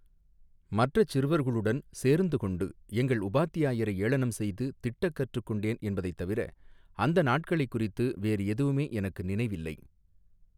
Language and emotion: Tamil, neutral